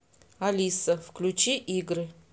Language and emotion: Russian, neutral